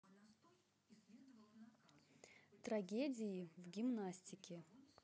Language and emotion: Russian, neutral